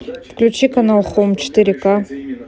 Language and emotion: Russian, neutral